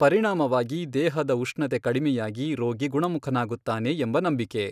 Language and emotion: Kannada, neutral